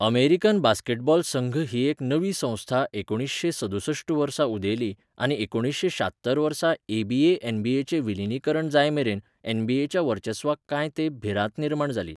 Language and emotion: Goan Konkani, neutral